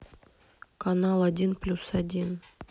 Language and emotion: Russian, neutral